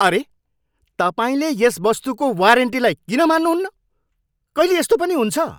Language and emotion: Nepali, angry